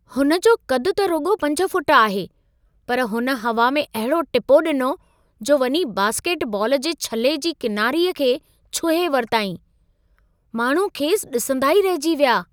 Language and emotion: Sindhi, surprised